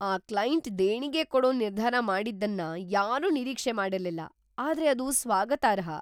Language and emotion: Kannada, surprised